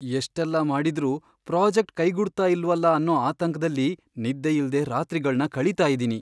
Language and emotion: Kannada, fearful